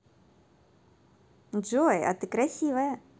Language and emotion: Russian, positive